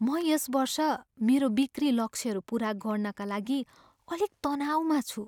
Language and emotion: Nepali, fearful